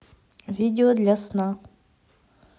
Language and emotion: Russian, neutral